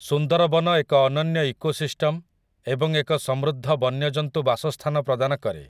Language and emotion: Odia, neutral